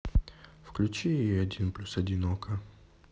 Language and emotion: Russian, neutral